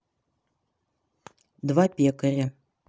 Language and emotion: Russian, neutral